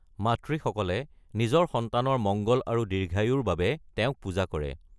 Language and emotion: Assamese, neutral